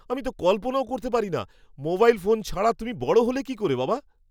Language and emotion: Bengali, surprised